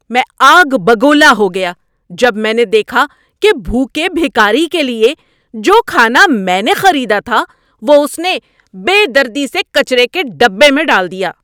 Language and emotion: Urdu, angry